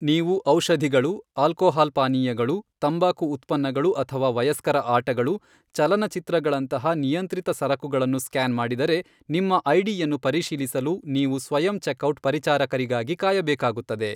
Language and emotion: Kannada, neutral